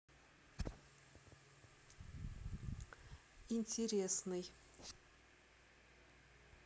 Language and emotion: Russian, neutral